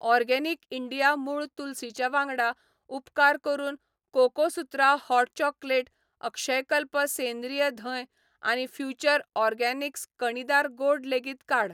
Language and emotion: Goan Konkani, neutral